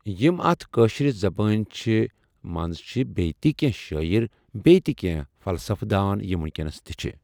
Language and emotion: Kashmiri, neutral